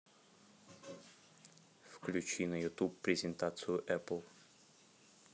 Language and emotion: Russian, neutral